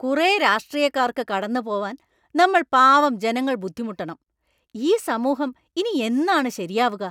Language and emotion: Malayalam, angry